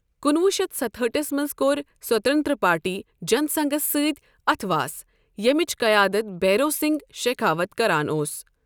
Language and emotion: Kashmiri, neutral